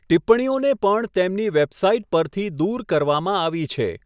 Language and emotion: Gujarati, neutral